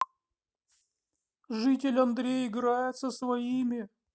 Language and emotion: Russian, sad